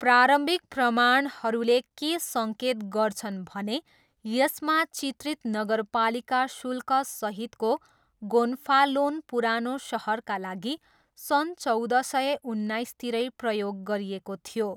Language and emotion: Nepali, neutral